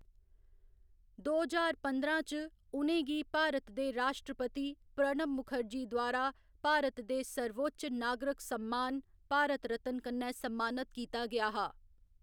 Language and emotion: Dogri, neutral